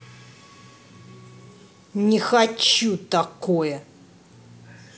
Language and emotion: Russian, angry